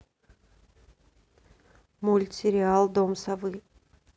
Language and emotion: Russian, neutral